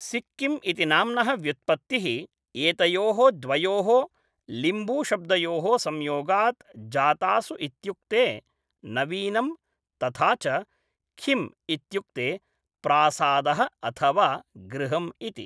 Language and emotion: Sanskrit, neutral